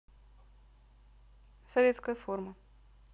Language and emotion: Russian, neutral